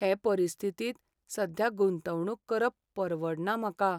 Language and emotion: Goan Konkani, sad